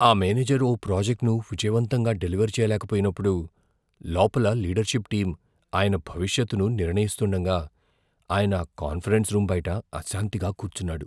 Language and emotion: Telugu, fearful